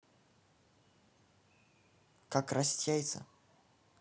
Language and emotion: Russian, neutral